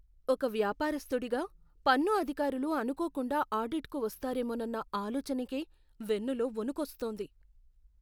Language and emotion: Telugu, fearful